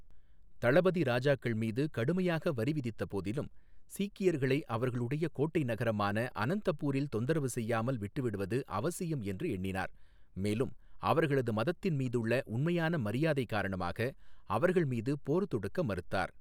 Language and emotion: Tamil, neutral